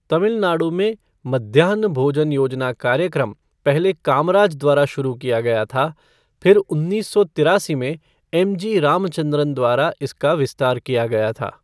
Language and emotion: Hindi, neutral